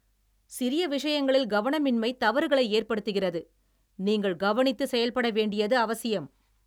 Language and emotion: Tamil, angry